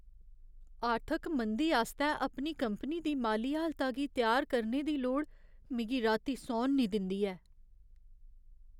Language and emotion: Dogri, fearful